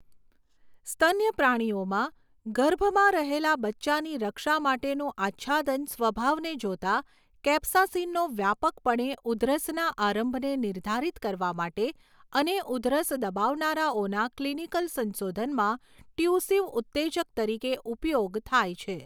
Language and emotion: Gujarati, neutral